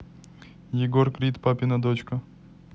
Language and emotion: Russian, neutral